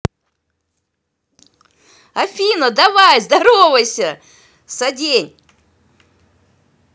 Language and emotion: Russian, positive